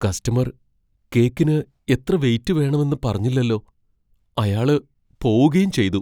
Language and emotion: Malayalam, fearful